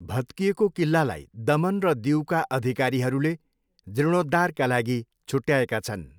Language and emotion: Nepali, neutral